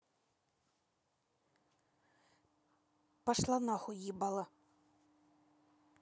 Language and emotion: Russian, angry